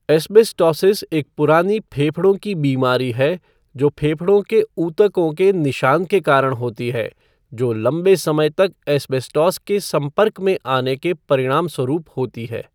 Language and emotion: Hindi, neutral